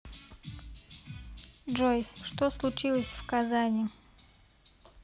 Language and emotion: Russian, neutral